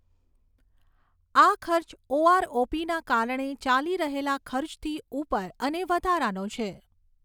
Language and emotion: Gujarati, neutral